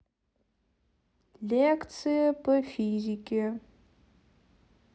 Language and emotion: Russian, neutral